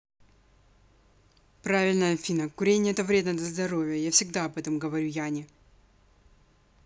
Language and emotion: Russian, angry